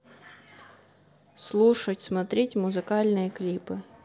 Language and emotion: Russian, neutral